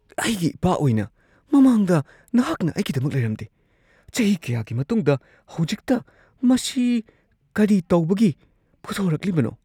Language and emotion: Manipuri, surprised